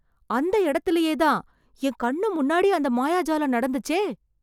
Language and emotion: Tamil, surprised